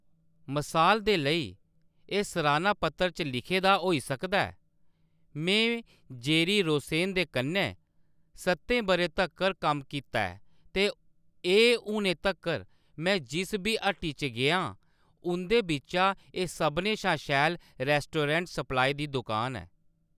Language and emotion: Dogri, neutral